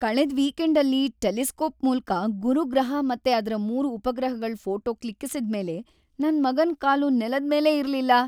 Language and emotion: Kannada, happy